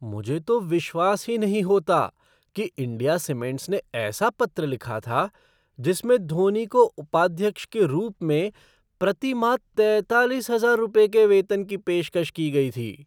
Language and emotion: Hindi, surprised